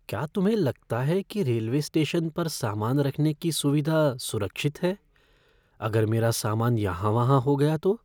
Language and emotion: Hindi, fearful